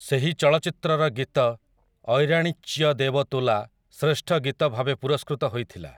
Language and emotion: Odia, neutral